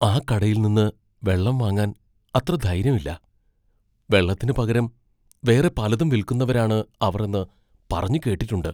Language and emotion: Malayalam, fearful